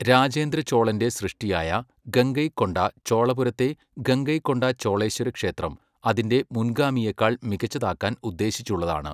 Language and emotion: Malayalam, neutral